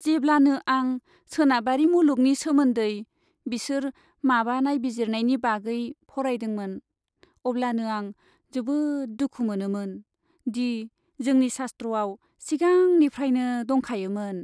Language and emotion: Bodo, sad